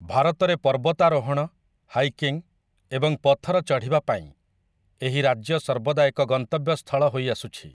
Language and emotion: Odia, neutral